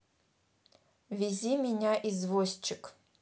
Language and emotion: Russian, neutral